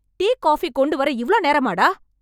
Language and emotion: Tamil, angry